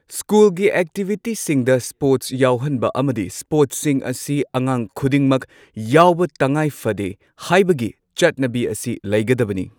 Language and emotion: Manipuri, neutral